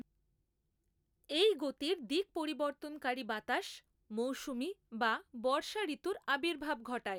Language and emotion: Bengali, neutral